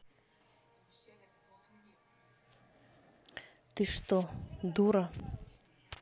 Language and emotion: Russian, neutral